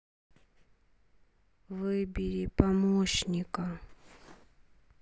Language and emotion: Russian, neutral